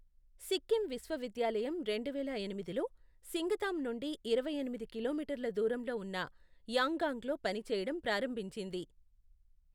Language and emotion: Telugu, neutral